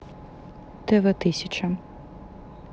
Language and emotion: Russian, neutral